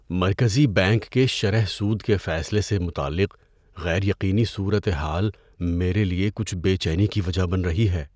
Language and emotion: Urdu, fearful